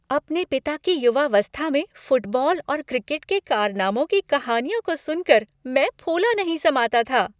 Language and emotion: Hindi, happy